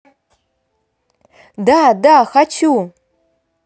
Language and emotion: Russian, positive